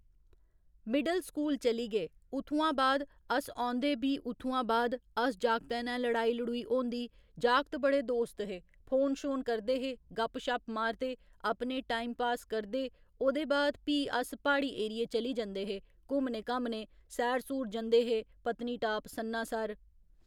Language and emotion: Dogri, neutral